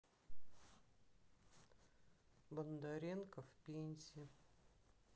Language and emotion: Russian, sad